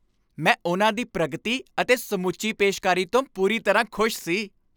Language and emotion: Punjabi, happy